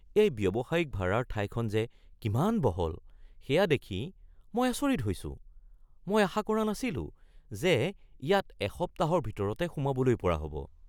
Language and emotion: Assamese, surprised